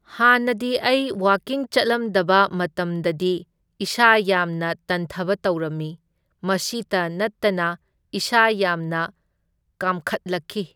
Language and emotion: Manipuri, neutral